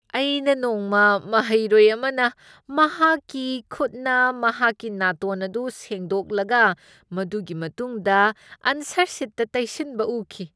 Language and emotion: Manipuri, disgusted